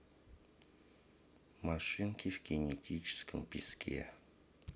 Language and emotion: Russian, neutral